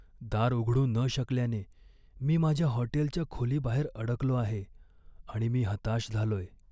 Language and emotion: Marathi, sad